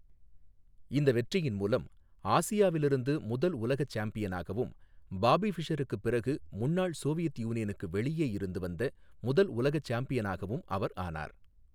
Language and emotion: Tamil, neutral